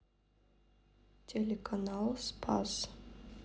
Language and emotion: Russian, neutral